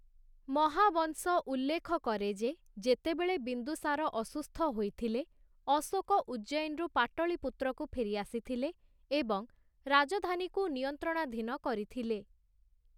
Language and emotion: Odia, neutral